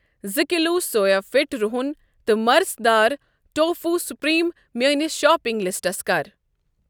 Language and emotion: Kashmiri, neutral